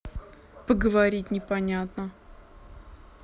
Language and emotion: Russian, neutral